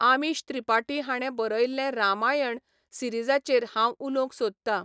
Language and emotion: Goan Konkani, neutral